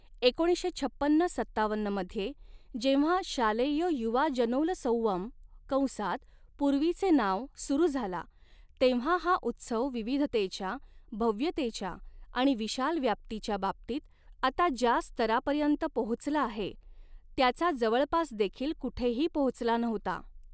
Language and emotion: Marathi, neutral